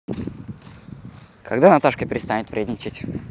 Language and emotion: Russian, neutral